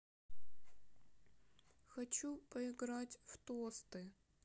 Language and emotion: Russian, sad